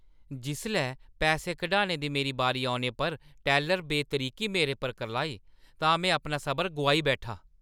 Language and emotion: Dogri, angry